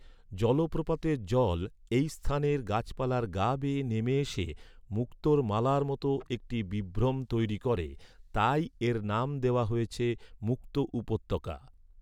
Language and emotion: Bengali, neutral